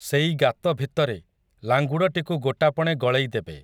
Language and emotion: Odia, neutral